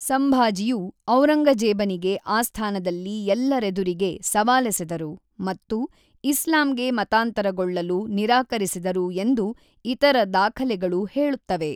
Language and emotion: Kannada, neutral